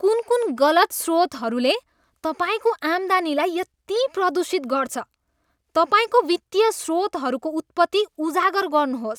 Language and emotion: Nepali, disgusted